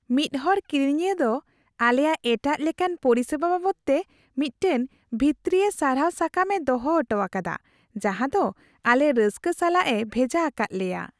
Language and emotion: Santali, happy